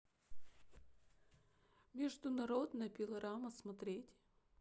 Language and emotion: Russian, sad